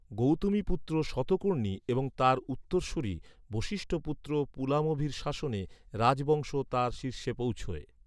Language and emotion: Bengali, neutral